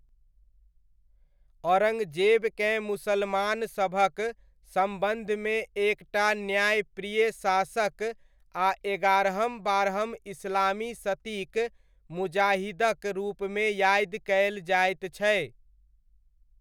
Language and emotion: Maithili, neutral